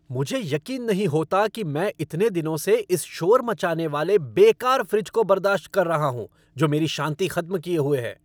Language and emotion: Hindi, angry